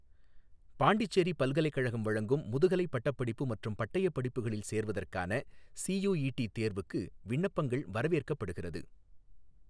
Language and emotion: Tamil, neutral